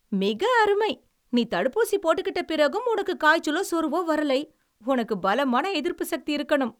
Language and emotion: Tamil, surprised